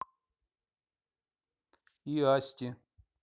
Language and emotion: Russian, neutral